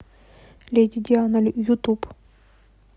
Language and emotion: Russian, neutral